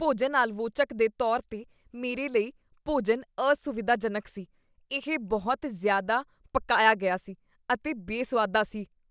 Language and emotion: Punjabi, disgusted